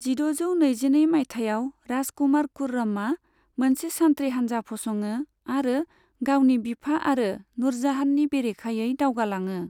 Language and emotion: Bodo, neutral